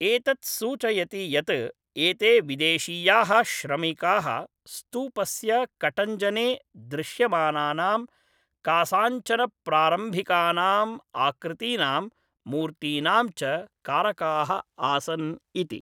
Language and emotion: Sanskrit, neutral